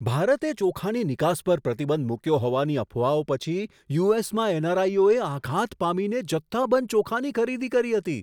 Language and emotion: Gujarati, surprised